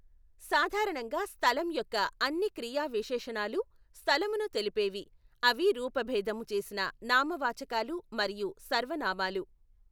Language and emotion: Telugu, neutral